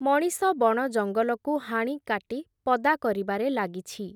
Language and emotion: Odia, neutral